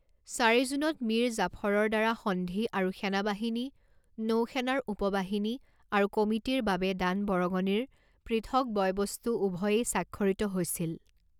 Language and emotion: Assamese, neutral